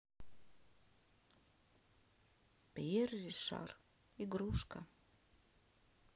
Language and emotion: Russian, sad